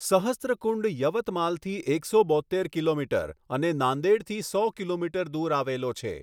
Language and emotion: Gujarati, neutral